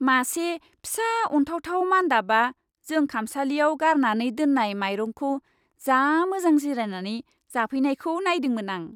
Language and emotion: Bodo, happy